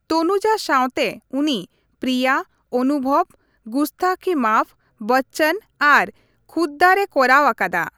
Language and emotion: Santali, neutral